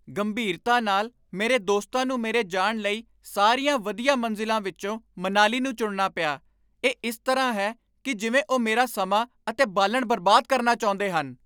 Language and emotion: Punjabi, angry